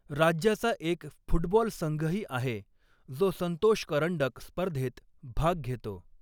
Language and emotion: Marathi, neutral